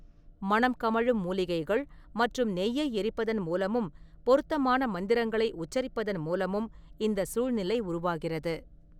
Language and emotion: Tamil, neutral